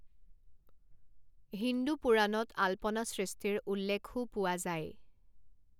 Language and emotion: Assamese, neutral